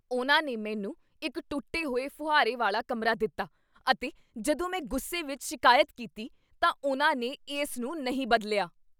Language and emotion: Punjabi, angry